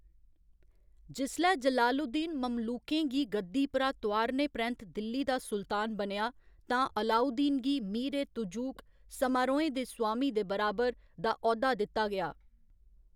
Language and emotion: Dogri, neutral